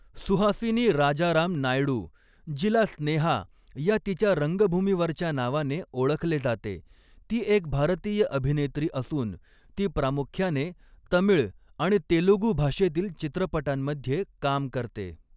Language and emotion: Marathi, neutral